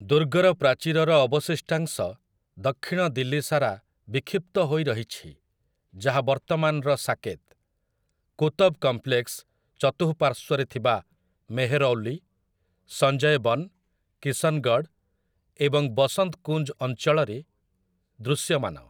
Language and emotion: Odia, neutral